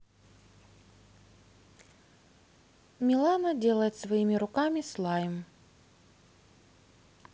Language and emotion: Russian, neutral